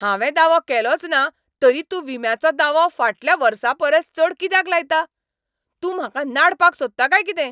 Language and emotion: Goan Konkani, angry